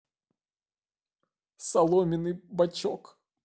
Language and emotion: Russian, sad